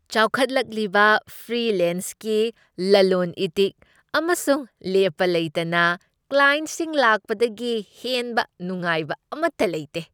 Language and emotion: Manipuri, happy